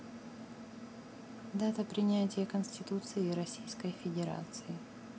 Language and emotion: Russian, neutral